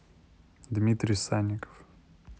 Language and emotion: Russian, neutral